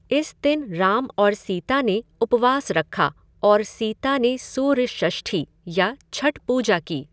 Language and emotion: Hindi, neutral